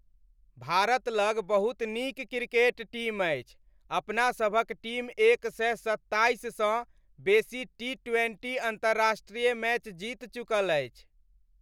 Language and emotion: Maithili, happy